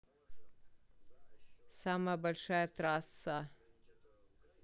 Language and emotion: Russian, neutral